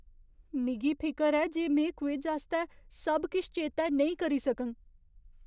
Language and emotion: Dogri, fearful